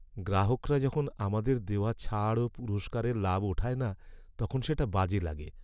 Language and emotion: Bengali, sad